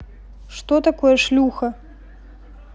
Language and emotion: Russian, neutral